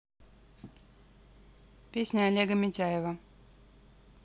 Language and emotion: Russian, neutral